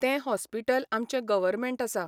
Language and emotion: Goan Konkani, neutral